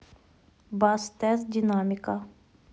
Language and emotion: Russian, neutral